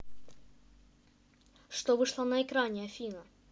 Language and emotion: Russian, neutral